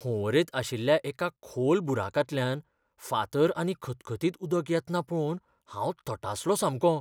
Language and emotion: Goan Konkani, fearful